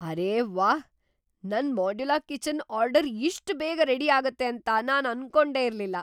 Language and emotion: Kannada, surprised